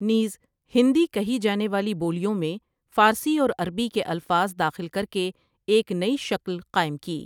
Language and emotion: Urdu, neutral